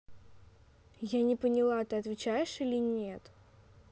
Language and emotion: Russian, angry